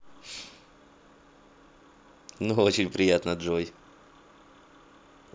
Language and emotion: Russian, positive